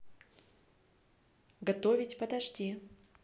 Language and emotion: Russian, neutral